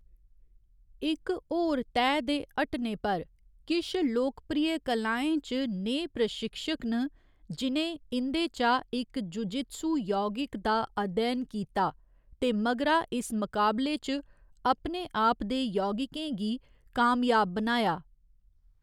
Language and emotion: Dogri, neutral